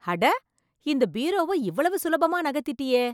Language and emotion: Tamil, surprised